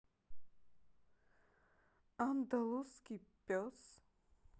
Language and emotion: Russian, neutral